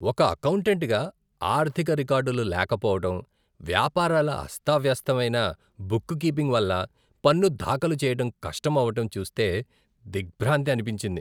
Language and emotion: Telugu, disgusted